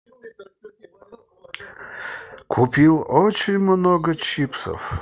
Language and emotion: Russian, positive